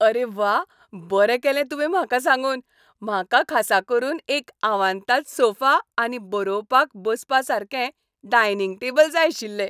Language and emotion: Goan Konkani, happy